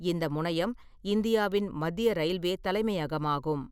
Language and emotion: Tamil, neutral